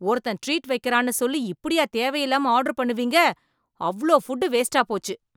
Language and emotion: Tamil, angry